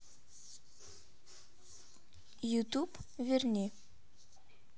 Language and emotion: Russian, neutral